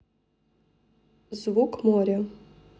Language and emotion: Russian, neutral